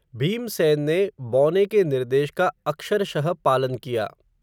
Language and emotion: Hindi, neutral